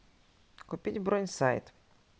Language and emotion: Russian, neutral